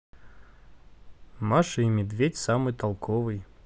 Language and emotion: Russian, neutral